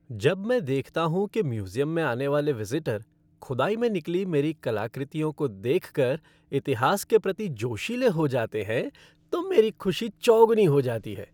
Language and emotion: Hindi, happy